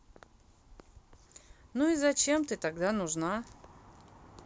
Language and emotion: Russian, angry